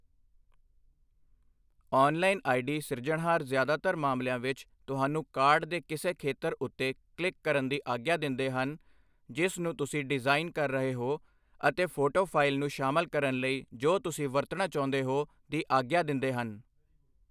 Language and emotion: Punjabi, neutral